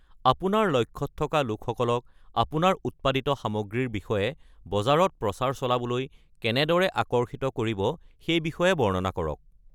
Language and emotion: Assamese, neutral